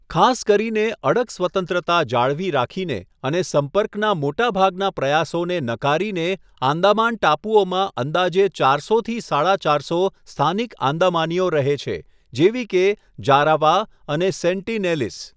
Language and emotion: Gujarati, neutral